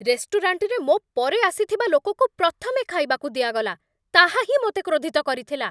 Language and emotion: Odia, angry